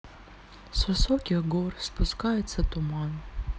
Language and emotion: Russian, sad